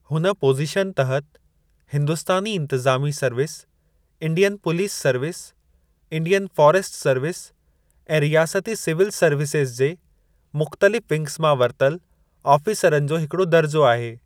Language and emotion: Sindhi, neutral